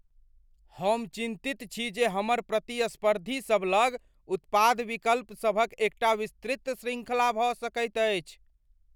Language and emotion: Maithili, fearful